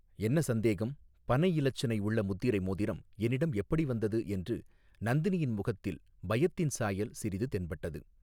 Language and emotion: Tamil, neutral